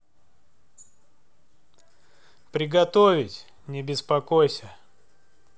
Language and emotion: Russian, neutral